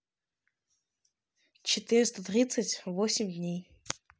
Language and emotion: Russian, neutral